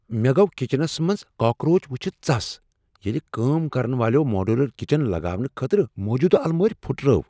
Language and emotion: Kashmiri, surprised